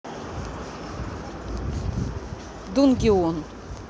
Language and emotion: Russian, neutral